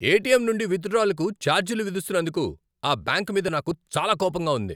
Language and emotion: Telugu, angry